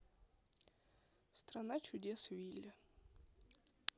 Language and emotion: Russian, neutral